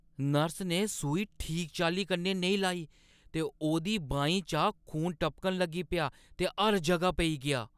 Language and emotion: Dogri, disgusted